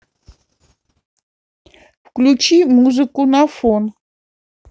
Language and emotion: Russian, neutral